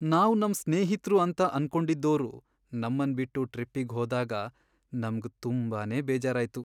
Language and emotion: Kannada, sad